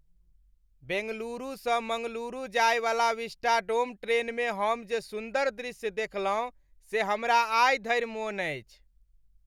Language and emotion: Maithili, happy